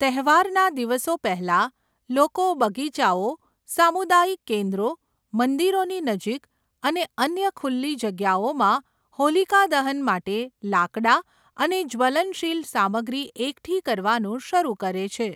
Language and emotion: Gujarati, neutral